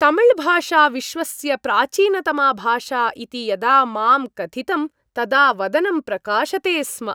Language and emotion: Sanskrit, happy